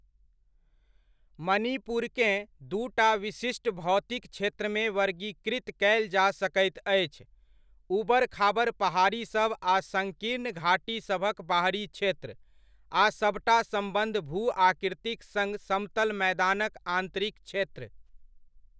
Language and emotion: Maithili, neutral